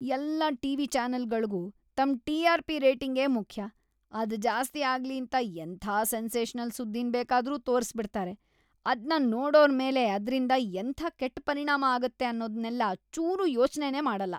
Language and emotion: Kannada, disgusted